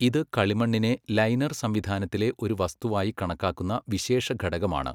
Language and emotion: Malayalam, neutral